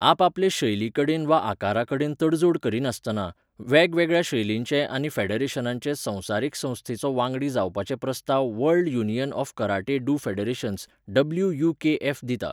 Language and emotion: Goan Konkani, neutral